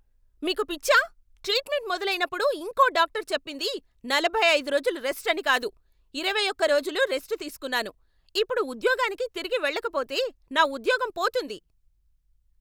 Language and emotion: Telugu, angry